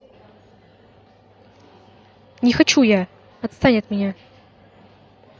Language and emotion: Russian, angry